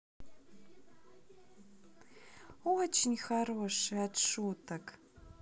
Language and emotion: Russian, positive